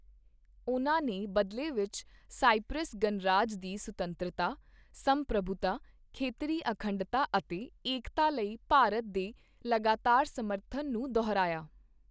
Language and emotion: Punjabi, neutral